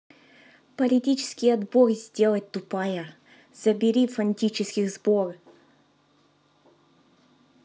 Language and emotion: Russian, angry